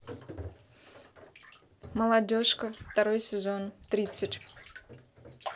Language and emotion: Russian, neutral